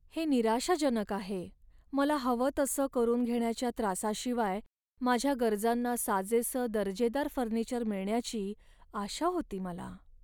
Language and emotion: Marathi, sad